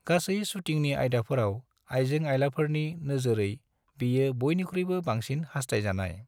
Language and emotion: Bodo, neutral